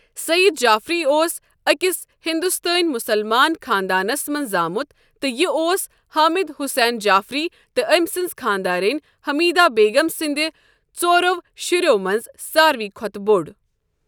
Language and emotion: Kashmiri, neutral